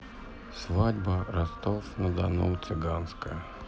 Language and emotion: Russian, sad